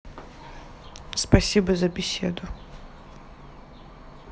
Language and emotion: Russian, neutral